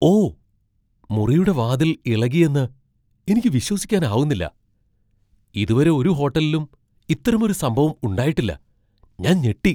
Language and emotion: Malayalam, surprised